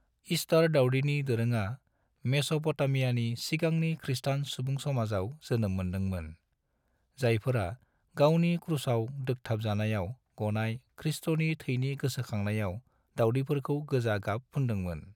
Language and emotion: Bodo, neutral